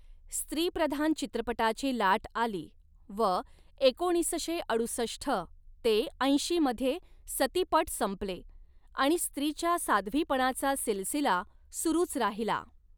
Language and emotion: Marathi, neutral